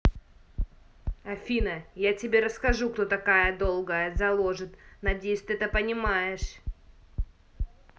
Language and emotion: Russian, angry